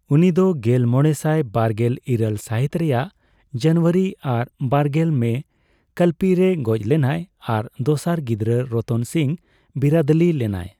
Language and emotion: Santali, neutral